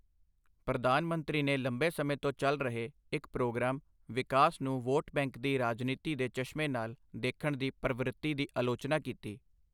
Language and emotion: Punjabi, neutral